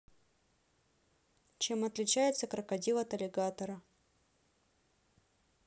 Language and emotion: Russian, neutral